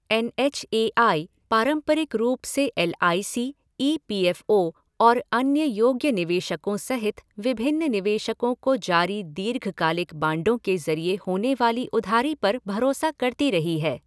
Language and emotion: Hindi, neutral